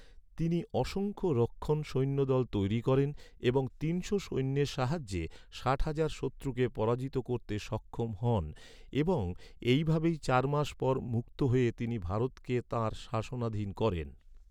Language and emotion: Bengali, neutral